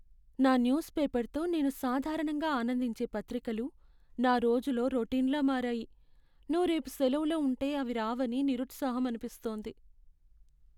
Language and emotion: Telugu, sad